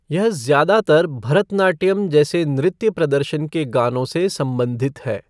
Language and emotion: Hindi, neutral